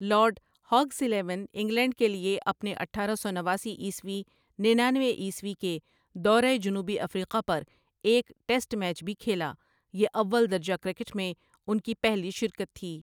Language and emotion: Urdu, neutral